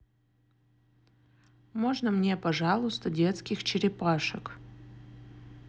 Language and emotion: Russian, neutral